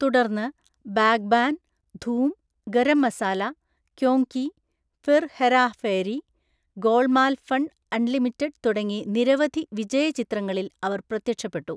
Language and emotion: Malayalam, neutral